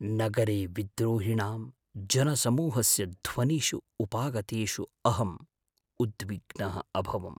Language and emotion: Sanskrit, fearful